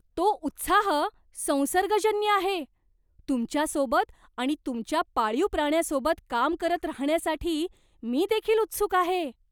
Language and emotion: Marathi, surprised